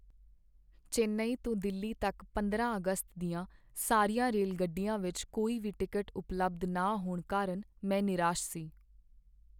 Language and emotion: Punjabi, sad